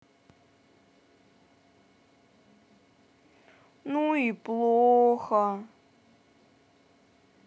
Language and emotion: Russian, sad